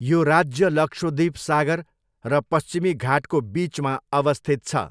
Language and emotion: Nepali, neutral